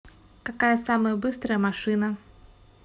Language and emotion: Russian, neutral